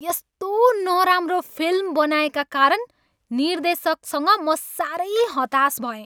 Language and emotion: Nepali, angry